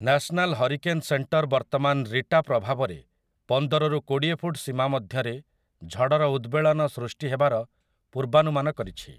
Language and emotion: Odia, neutral